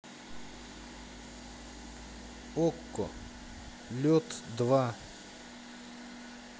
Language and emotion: Russian, neutral